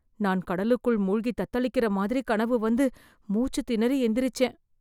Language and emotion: Tamil, fearful